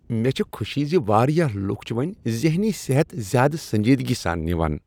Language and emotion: Kashmiri, happy